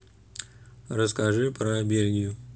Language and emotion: Russian, neutral